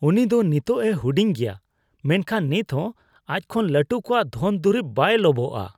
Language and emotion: Santali, disgusted